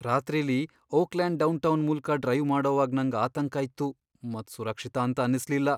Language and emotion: Kannada, fearful